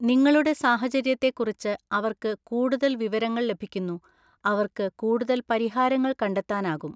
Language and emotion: Malayalam, neutral